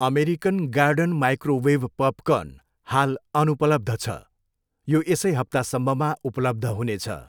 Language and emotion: Nepali, neutral